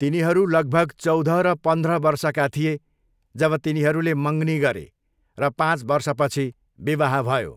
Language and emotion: Nepali, neutral